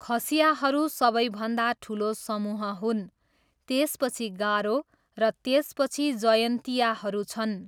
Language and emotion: Nepali, neutral